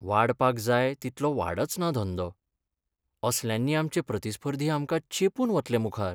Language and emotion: Goan Konkani, sad